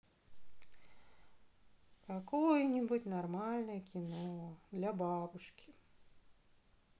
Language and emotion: Russian, sad